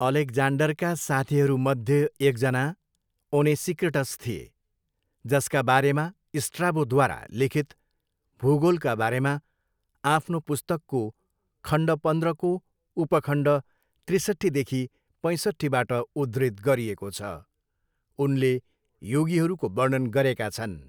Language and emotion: Nepali, neutral